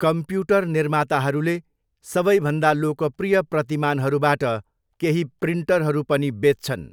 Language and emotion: Nepali, neutral